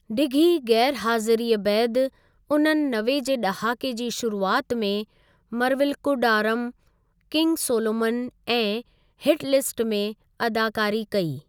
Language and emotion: Sindhi, neutral